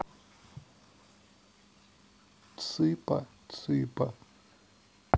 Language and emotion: Russian, sad